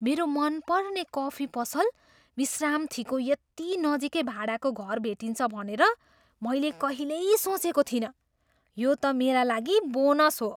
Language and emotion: Nepali, surprised